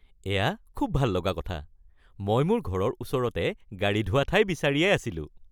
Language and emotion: Assamese, happy